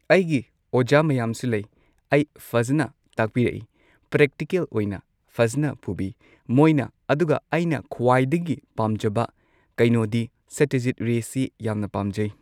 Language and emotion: Manipuri, neutral